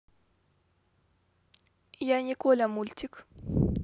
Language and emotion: Russian, neutral